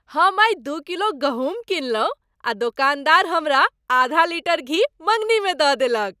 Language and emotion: Maithili, happy